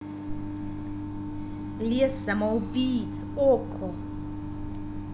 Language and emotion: Russian, neutral